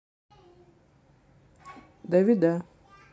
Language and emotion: Russian, neutral